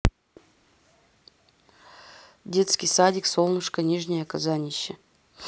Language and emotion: Russian, neutral